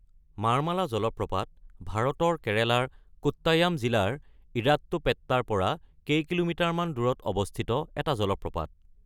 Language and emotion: Assamese, neutral